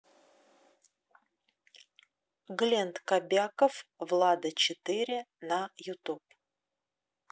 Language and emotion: Russian, neutral